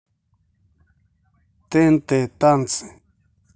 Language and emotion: Russian, neutral